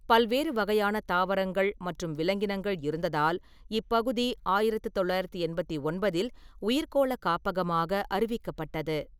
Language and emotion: Tamil, neutral